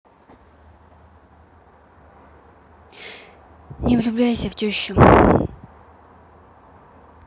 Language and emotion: Russian, sad